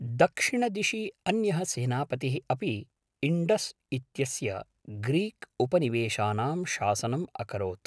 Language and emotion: Sanskrit, neutral